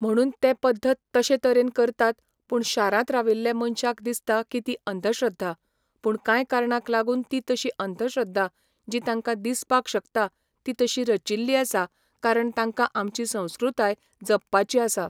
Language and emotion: Goan Konkani, neutral